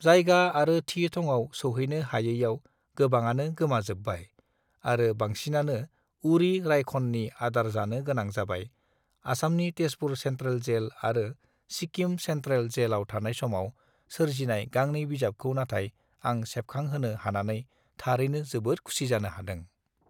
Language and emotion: Bodo, neutral